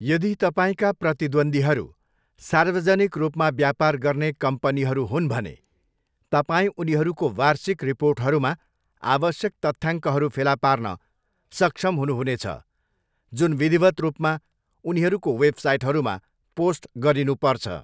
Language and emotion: Nepali, neutral